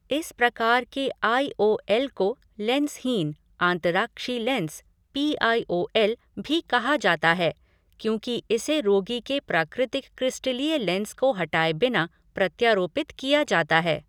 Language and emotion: Hindi, neutral